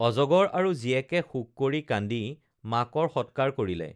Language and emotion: Assamese, neutral